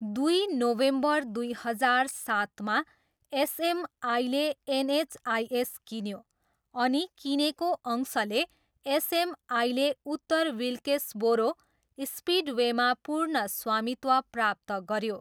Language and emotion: Nepali, neutral